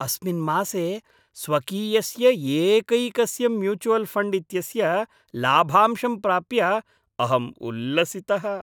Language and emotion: Sanskrit, happy